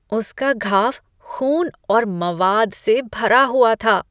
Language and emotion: Hindi, disgusted